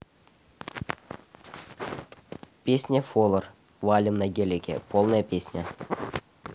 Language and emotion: Russian, neutral